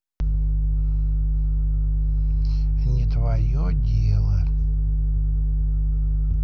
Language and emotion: Russian, neutral